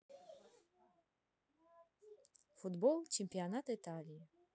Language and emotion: Russian, neutral